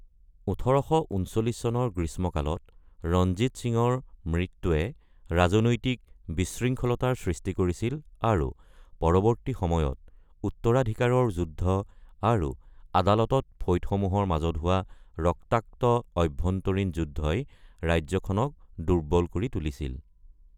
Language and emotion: Assamese, neutral